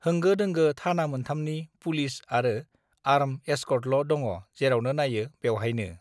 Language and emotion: Bodo, neutral